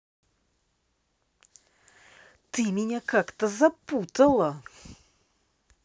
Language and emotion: Russian, angry